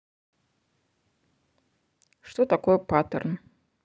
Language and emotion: Russian, neutral